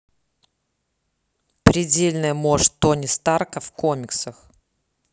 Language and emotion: Russian, neutral